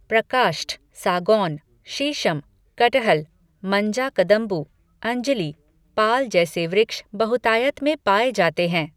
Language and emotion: Hindi, neutral